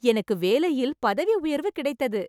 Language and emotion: Tamil, happy